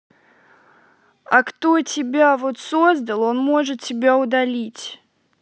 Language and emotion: Russian, angry